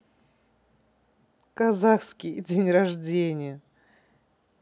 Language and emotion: Russian, positive